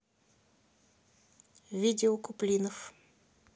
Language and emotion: Russian, neutral